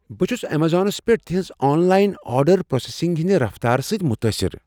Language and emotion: Kashmiri, surprised